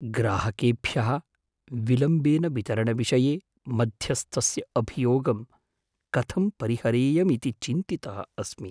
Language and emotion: Sanskrit, fearful